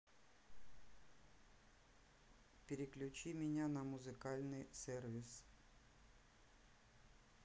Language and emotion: Russian, neutral